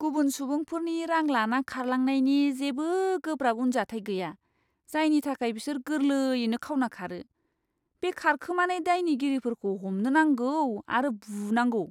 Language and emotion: Bodo, disgusted